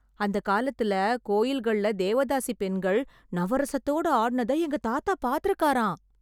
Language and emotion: Tamil, surprised